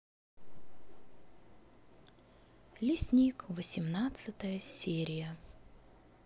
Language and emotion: Russian, neutral